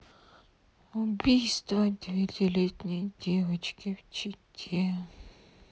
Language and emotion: Russian, sad